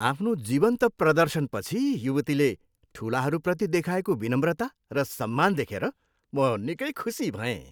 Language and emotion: Nepali, happy